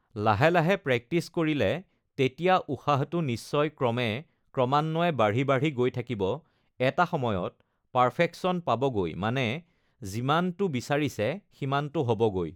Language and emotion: Assamese, neutral